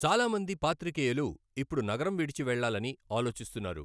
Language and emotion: Telugu, neutral